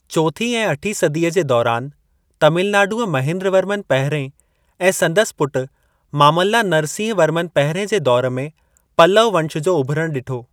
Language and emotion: Sindhi, neutral